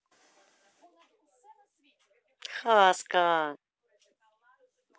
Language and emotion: Russian, neutral